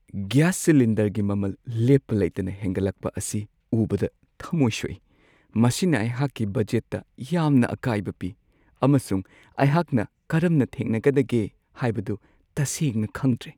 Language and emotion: Manipuri, sad